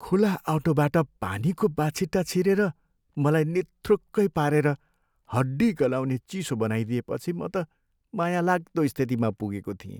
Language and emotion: Nepali, sad